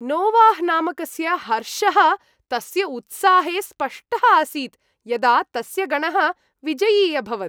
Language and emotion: Sanskrit, happy